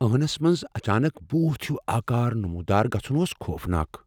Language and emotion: Kashmiri, fearful